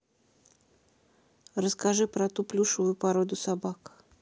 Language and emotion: Russian, neutral